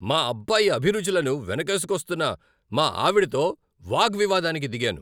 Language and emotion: Telugu, angry